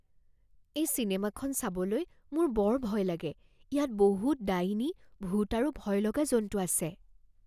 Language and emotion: Assamese, fearful